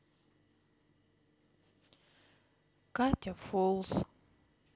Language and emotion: Russian, sad